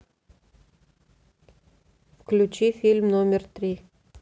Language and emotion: Russian, neutral